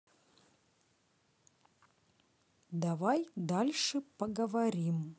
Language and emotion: Russian, neutral